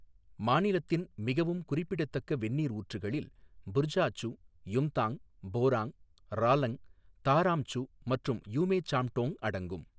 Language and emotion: Tamil, neutral